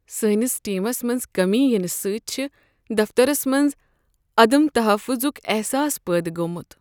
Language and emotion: Kashmiri, sad